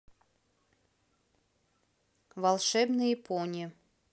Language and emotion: Russian, neutral